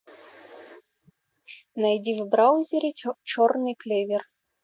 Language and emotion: Russian, neutral